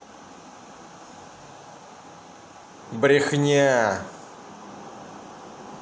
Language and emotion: Russian, angry